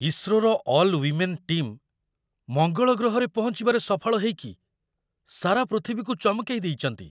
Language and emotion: Odia, surprised